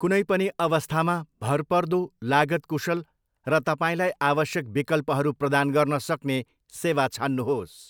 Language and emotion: Nepali, neutral